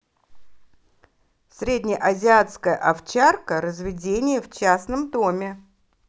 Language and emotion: Russian, positive